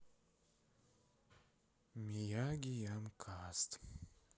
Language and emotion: Russian, sad